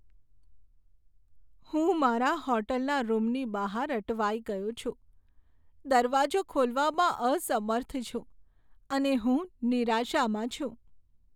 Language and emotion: Gujarati, sad